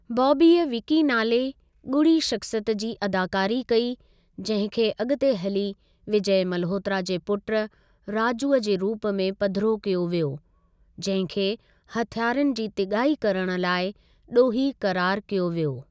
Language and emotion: Sindhi, neutral